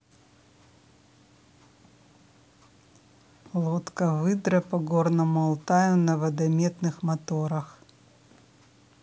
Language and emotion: Russian, neutral